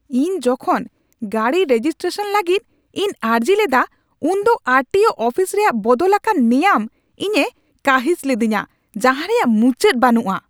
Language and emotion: Santali, angry